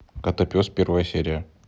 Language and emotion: Russian, neutral